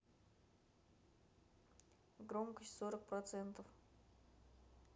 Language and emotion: Russian, neutral